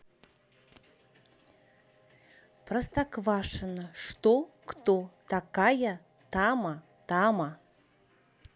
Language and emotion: Russian, neutral